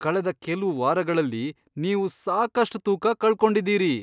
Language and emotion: Kannada, surprised